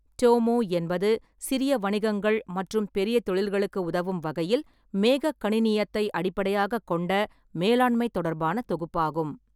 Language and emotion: Tamil, neutral